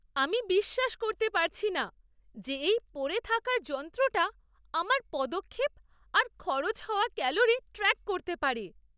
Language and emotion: Bengali, surprised